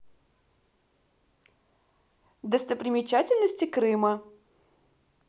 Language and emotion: Russian, positive